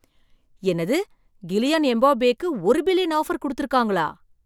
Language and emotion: Tamil, surprised